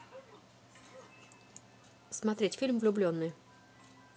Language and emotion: Russian, neutral